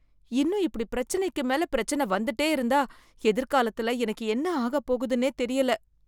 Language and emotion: Tamil, fearful